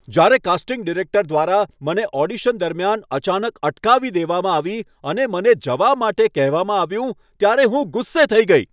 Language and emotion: Gujarati, angry